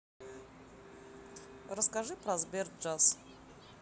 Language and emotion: Russian, neutral